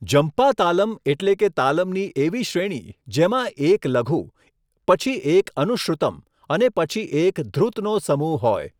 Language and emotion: Gujarati, neutral